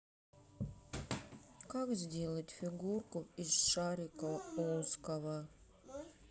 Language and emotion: Russian, sad